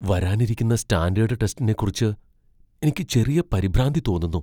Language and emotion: Malayalam, fearful